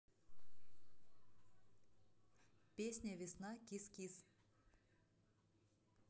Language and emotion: Russian, neutral